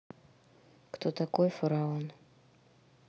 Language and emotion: Russian, neutral